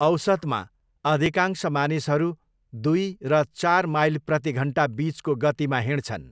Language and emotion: Nepali, neutral